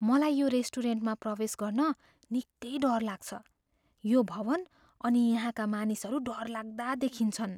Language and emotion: Nepali, fearful